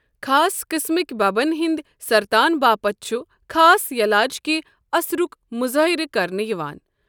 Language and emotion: Kashmiri, neutral